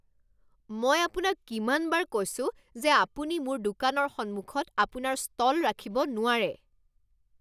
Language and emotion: Assamese, angry